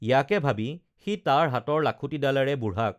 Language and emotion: Assamese, neutral